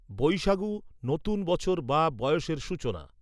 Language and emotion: Bengali, neutral